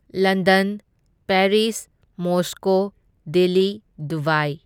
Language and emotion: Manipuri, neutral